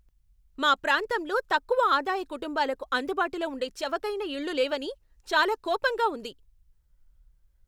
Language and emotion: Telugu, angry